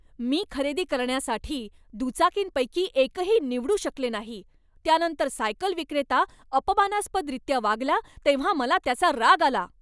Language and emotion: Marathi, angry